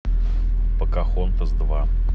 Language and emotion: Russian, neutral